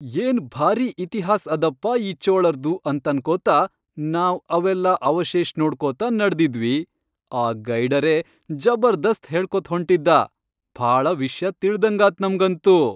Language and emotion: Kannada, happy